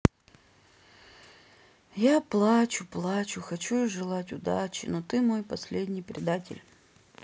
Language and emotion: Russian, sad